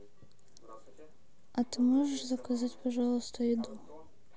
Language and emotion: Russian, neutral